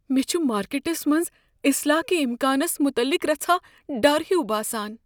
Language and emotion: Kashmiri, fearful